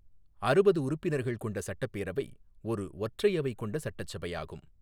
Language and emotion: Tamil, neutral